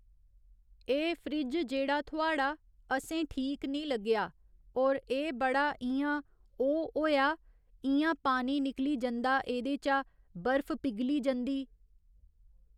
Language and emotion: Dogri, neutral